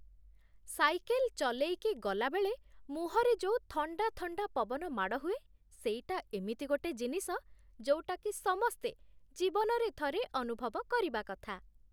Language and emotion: Odia, happy